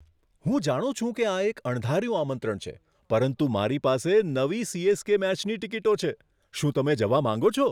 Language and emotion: Gujarati, surprised